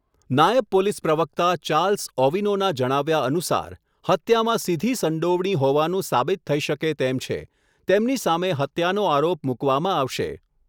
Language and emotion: Gujarati, neutral